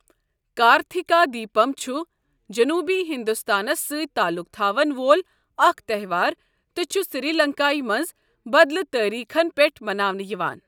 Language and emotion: Kashmiri, neutral